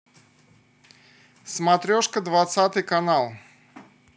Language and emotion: Russian, neutral